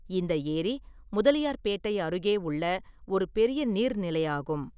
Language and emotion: Tamil, neutral